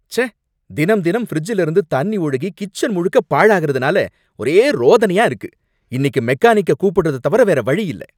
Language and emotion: Tamil, angry